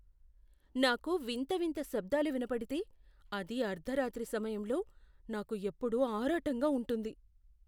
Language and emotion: Telugu, fearful